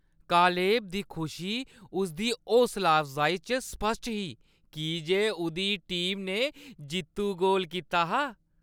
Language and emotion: Dogri, happy